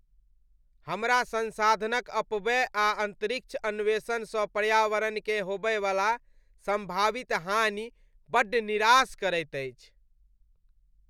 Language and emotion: Maithili, disgusted